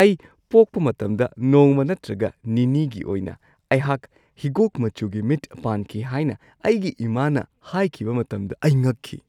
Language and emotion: Manipuri, surprised